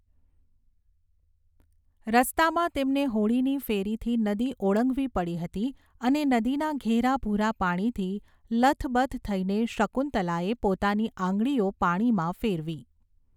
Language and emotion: Gujarati, neutral